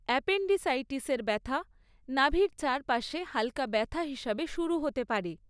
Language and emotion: Bengali, neutral